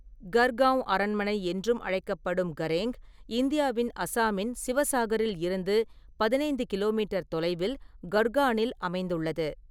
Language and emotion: Tamil, neutral